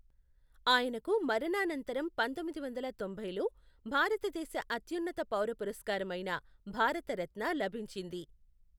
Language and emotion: Telugu, neutral